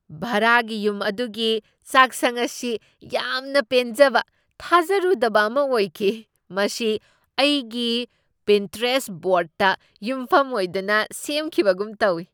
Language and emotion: Manipuri, surprised